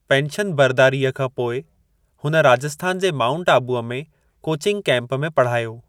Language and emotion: Sindhi, neutral